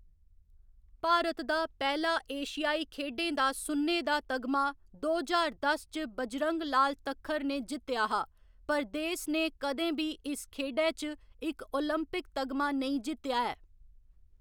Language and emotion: Dogri, neutral